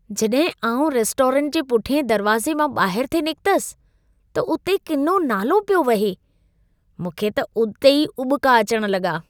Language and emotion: Sindhi, disgusted